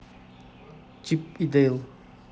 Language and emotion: Russian, neutral